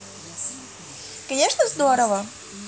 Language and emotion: Russian, positive